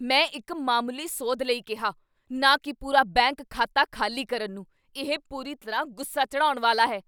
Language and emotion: Punjabi, angry